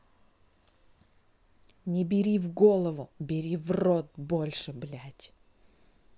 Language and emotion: Russian, angry